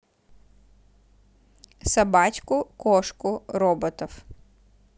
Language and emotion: Russian, neutral